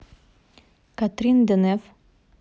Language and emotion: Russian, neutral